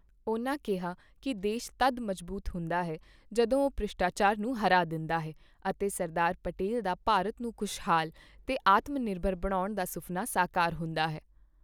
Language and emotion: Punjabi, neutral